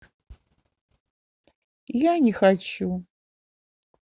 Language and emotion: Russian, sad